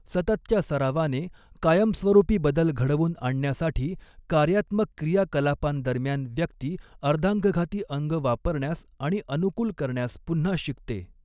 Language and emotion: Marathi, neutral